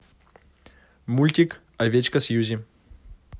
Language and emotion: Russian, positive